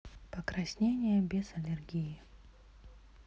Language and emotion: Russian, neutral